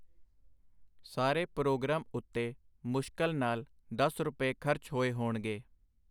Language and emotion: Punjabi, neutral